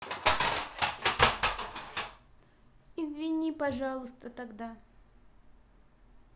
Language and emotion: Russian, sad